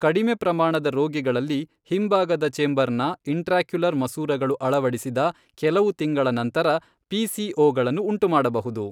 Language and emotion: Kannada, neutral